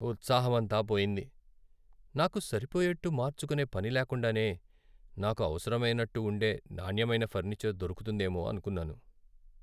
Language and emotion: Telugu, sad